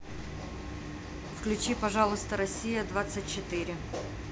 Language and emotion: Russian, neutral